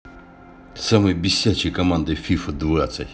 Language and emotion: Russian, angry